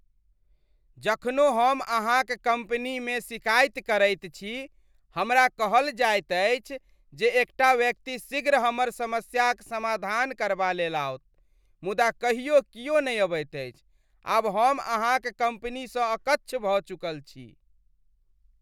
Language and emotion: Maithili, disgusted